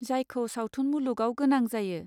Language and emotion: Bodo, neutral